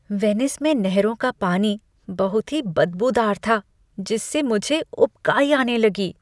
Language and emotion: Hindi, disgusted